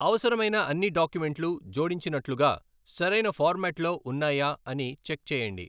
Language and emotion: Telugu, neutral